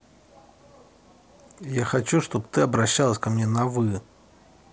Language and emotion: Russian, neutral